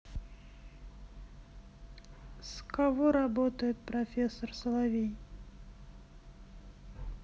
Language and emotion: Russian, neutral